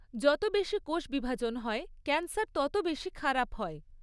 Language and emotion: Bengali, neutral